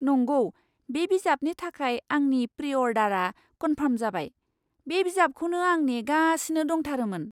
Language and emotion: Bodo, surprised